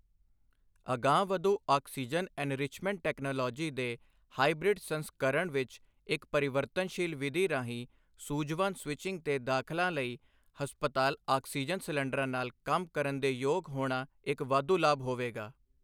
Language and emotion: Punjabi, neutral